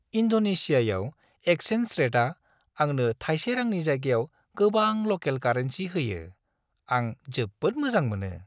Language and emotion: Bodo, happy